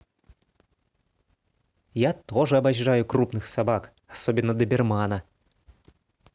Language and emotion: Russian, positive